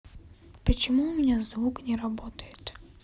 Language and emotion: Russian, sad